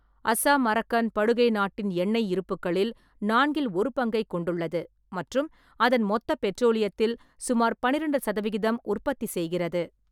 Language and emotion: Tamil, neutral